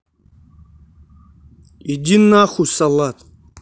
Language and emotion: Russian, angry